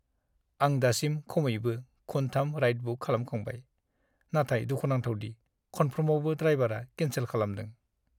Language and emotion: Bodo, sad